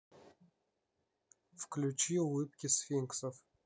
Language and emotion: Russian, neutral